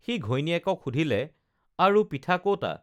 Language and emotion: Assamese, neutral